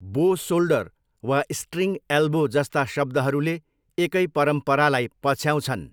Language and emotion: Nepali, neutral